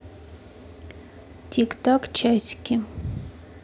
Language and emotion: Russian, neutral